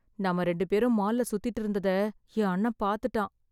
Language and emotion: Tamil, fearful